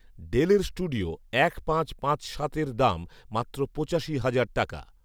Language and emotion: Bengali, neutral